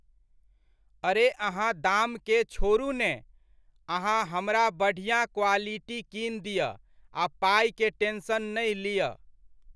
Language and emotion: Maithili, neutral